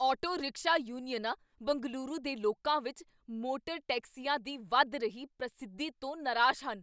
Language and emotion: Punjabi, angry